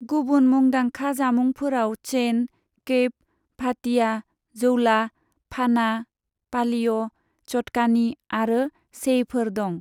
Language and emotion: Bodo, neutral